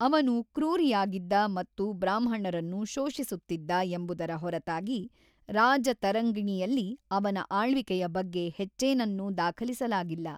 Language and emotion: Kannada, neutral